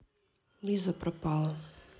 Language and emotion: Russian, sad